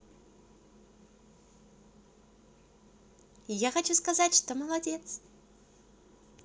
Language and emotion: Russian, positive